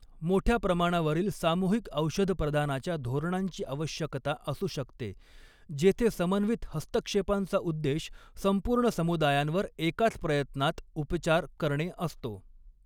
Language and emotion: Marathi, neutral